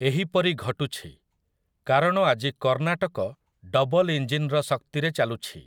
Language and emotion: Odia, neutral